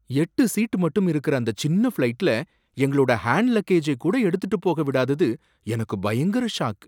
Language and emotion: Tamil, surprised